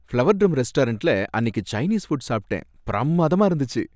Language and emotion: Tamil, happy